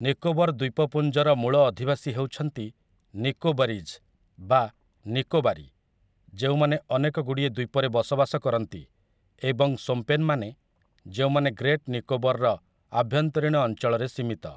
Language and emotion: Odia, neutral